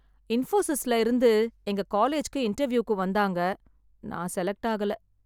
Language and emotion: Tamil, sad